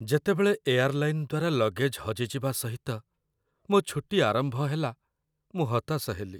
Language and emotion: Odia, sad